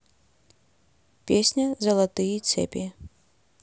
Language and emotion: Russian, neutral